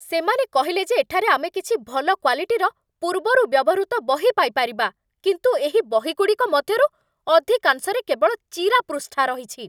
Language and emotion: Odia, angry